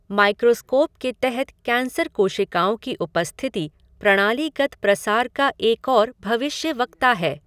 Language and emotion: Hindi, neutral